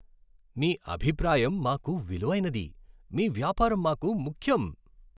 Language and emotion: Telugu, happy